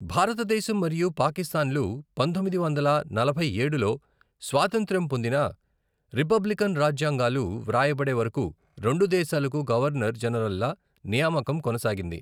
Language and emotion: Telugu, neutral